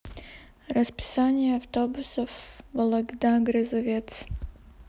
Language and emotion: Russian, neutral